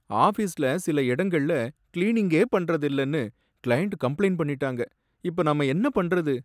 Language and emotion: Tamil, sad